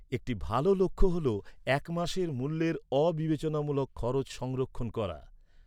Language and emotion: Bengali, neutral